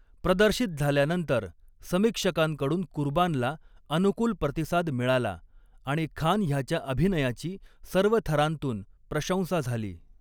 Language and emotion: Marathi, neutral